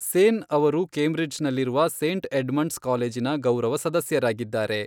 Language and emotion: Kannada, neutral